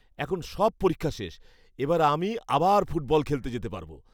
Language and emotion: Bengali, happy